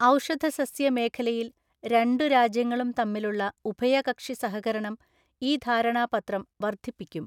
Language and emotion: Malayalam, neutral